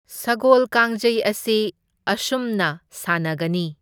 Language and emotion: Manipuri, neutral